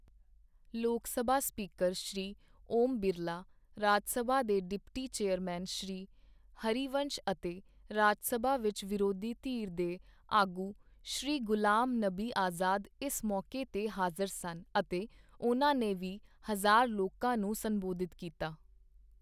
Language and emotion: Punjabi, neutral